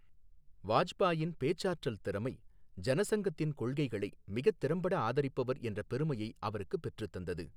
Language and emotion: Tamil, neutral